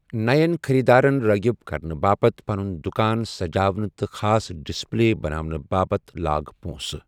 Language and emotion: Kashmiri, neutral